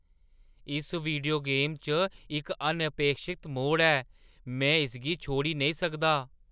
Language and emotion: Dogri, surprised